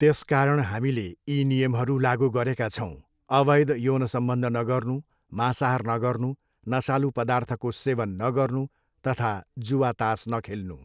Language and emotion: Nepali, neutral